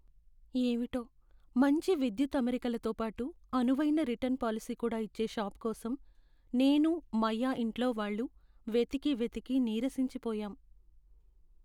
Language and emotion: Telugu, sad